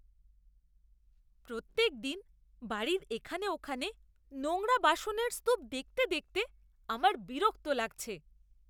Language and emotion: Bengali, disgusted